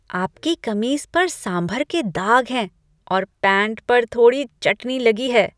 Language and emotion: Hindi, disgusted